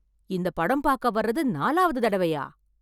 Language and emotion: Tamil, surprised